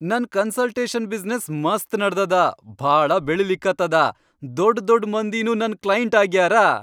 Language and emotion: Kannada, happy